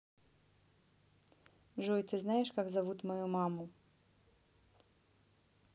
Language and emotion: Russian, neutral